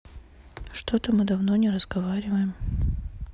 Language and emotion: Russian, neutral